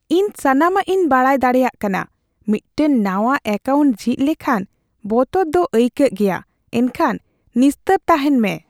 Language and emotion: Santali, fearful